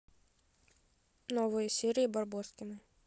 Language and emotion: Russian, neutral